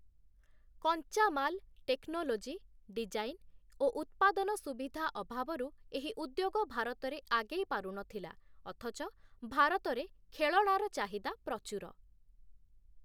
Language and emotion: Odia, neutral